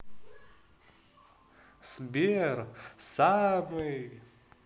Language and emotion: Russian, positive